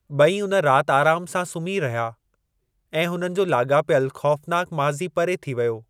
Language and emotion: Sindhi, neutral